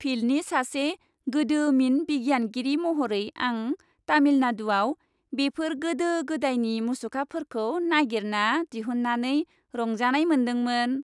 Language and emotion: Bodo, happy